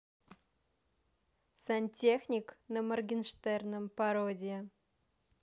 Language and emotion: Russian, positive